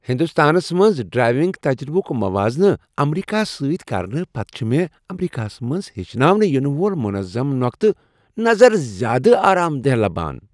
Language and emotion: Kashmiri, happy